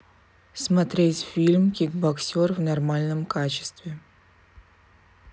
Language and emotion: Russian, neutral